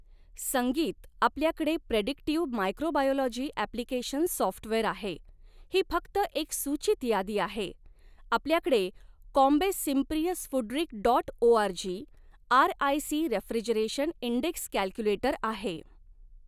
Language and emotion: Marathi, neutral